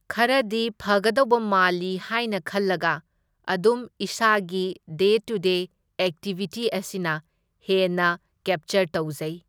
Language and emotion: Manipuri, neutral